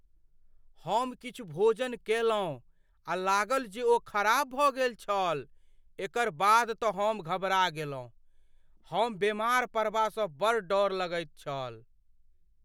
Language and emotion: Maithili, fearful